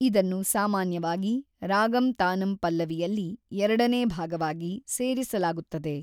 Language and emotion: Kannada, neutral